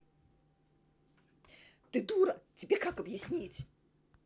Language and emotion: Russian, angry